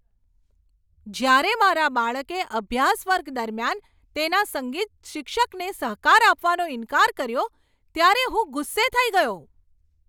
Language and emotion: Gujarati, angry